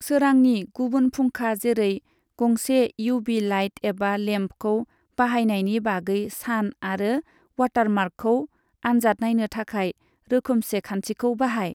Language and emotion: Bodo, neutral